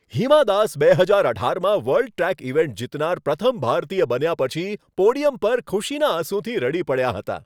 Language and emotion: Gujarati, happy